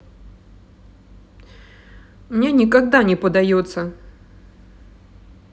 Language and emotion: Russian, sad